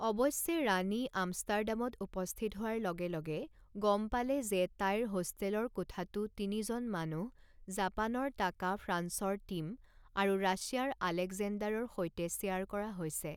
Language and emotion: Assamese, neutral